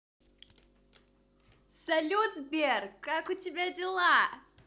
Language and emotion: Russian, positive